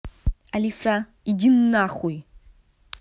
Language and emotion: Russian, angry